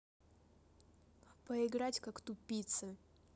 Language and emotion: Russian, neutral